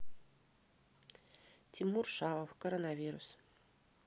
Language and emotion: Russian, neutral